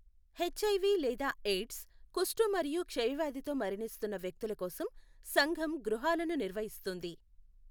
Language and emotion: Telugu, neutral